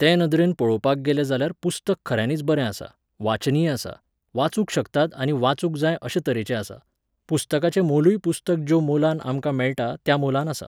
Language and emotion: Goan Konkani, neutral